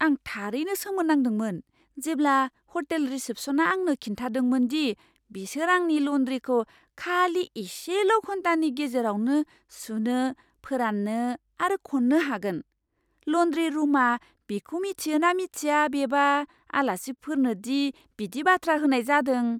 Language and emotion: Bodo, surprised